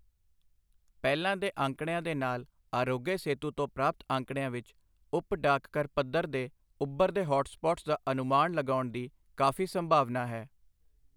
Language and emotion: Punjabi, neutral